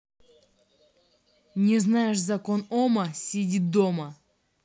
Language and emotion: Russian, angry